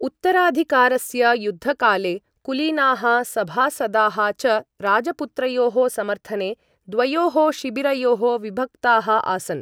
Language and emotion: Sanskrit, neutral